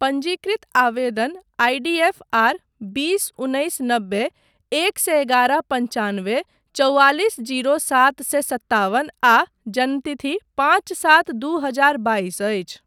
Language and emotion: Maithili, neutral